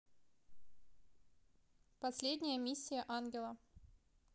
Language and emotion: Russian, neutral